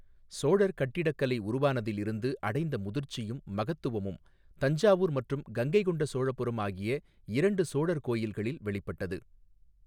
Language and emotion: Tamil, neutral